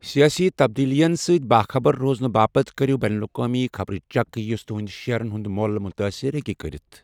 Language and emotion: Kashmiri, neutral